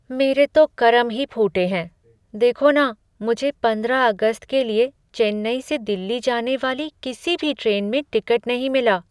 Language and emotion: Hindi, sad